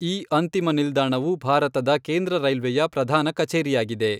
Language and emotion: Kannada, neutral